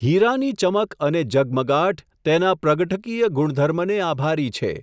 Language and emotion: Gujarati, neutral